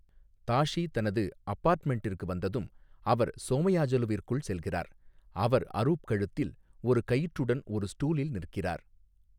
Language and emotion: Tamil, neutral